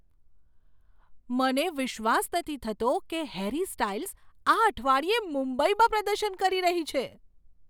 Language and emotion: Gujarati, surprised